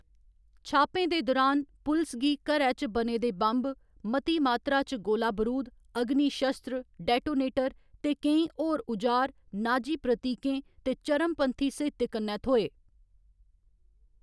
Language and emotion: Dogri, neutral